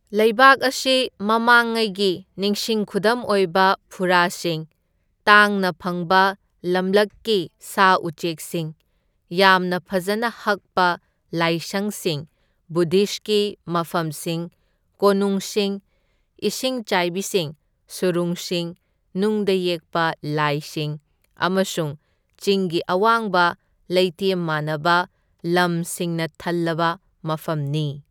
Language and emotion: Manipuri, neutral